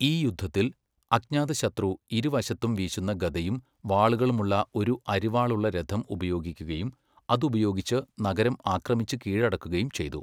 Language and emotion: Malayalam, neutral